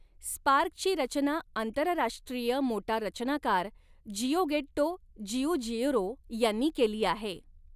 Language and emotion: Marathi, neutral